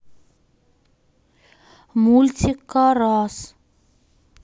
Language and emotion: Russian, neutral